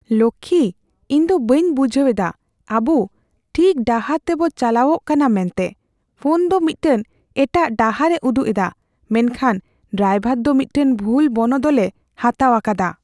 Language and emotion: Santali, fearful